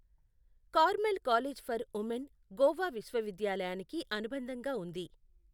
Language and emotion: Telugu, neutral